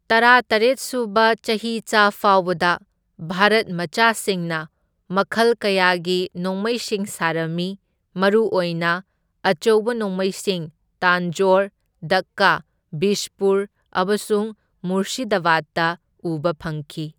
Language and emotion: Manipuri, neutral